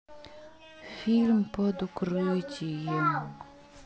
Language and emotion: Russian, sad